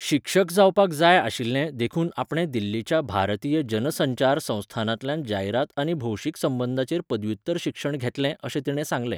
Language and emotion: Goan Konkani, neutral